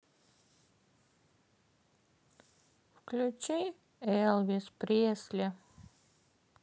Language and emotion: Russian, sad